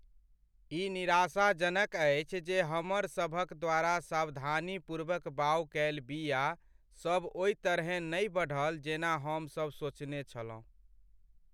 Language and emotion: Maithili, sad